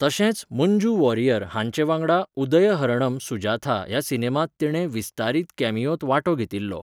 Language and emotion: Goan Konkani, neutral